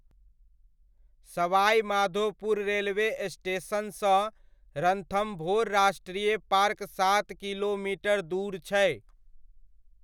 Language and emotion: Maithili, neutral